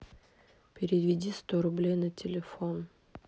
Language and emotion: Russian, sad